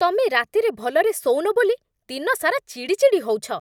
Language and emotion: Odia, angry